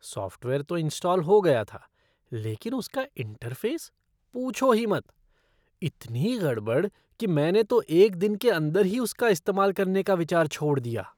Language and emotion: Hindi, disgusted